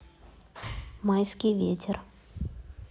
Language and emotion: Russian, neutral